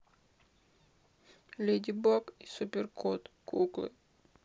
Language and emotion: Russian, sad